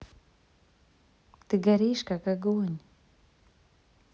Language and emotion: Russian, neutral